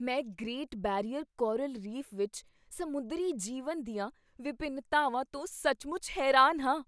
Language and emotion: Punjabi, surprised